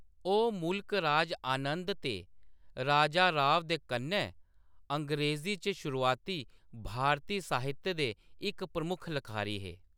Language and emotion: Dogri, neutral